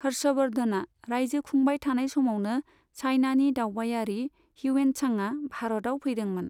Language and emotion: Bodo, neutral